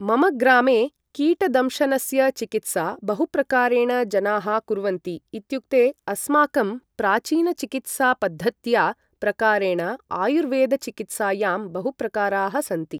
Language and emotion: Sanskrit, neutral